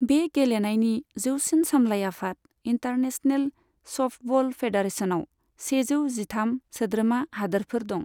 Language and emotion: Bodo, neutral